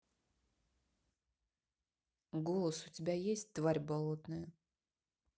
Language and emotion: Russian, neutral